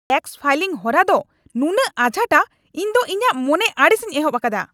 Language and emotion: Santali, angry